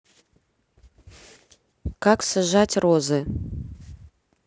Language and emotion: Russian, neutral